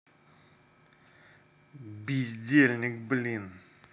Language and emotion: Russian, angry